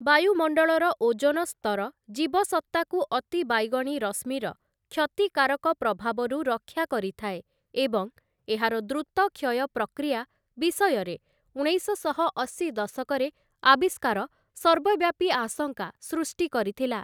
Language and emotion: Odia, neutral